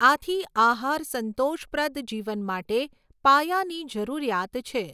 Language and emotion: Gujarati, neutral